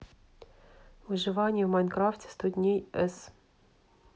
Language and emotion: Russian, neutral